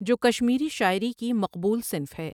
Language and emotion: Urdu, neutral